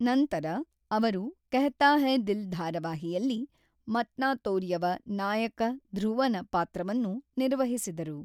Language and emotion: Kannada, neutral